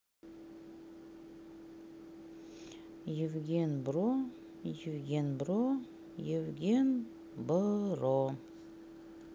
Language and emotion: Russian, neutral